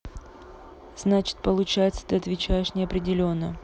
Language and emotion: Russian, neutral